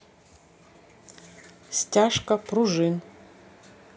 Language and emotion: Russian, neutral